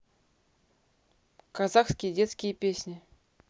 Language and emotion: Russian, neutral